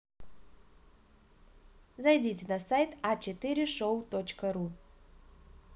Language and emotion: Russian, positive